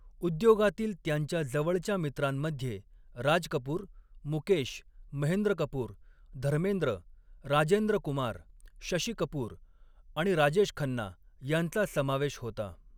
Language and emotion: Marathi, neutral